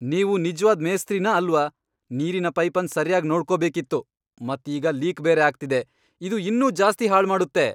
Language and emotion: Kannada, angry